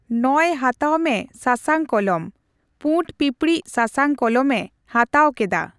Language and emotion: Santali, neutral